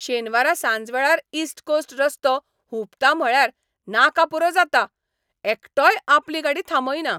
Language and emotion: Goan Konkani, angry